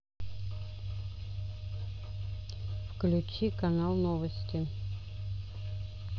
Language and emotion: Russian, neutral